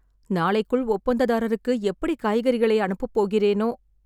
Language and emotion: Tamil, sad